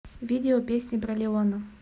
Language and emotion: Russian, neutral